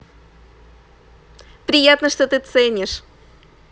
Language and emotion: Russian, positive